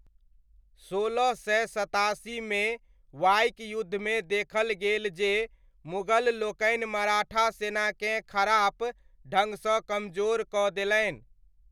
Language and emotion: Maithili, neutral